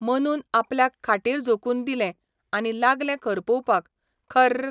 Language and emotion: Goan Konkani, neutral